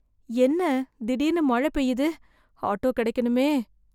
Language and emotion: Tamil, fearful